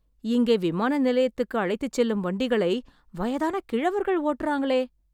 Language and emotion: Tamil, surprised